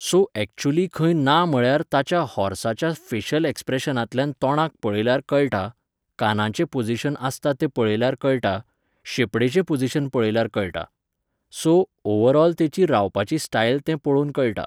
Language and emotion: Goan Konkani, neutral